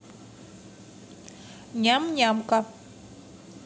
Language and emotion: Russian, positive